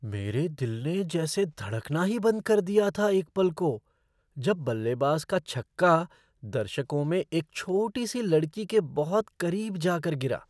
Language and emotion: Hindi, surprised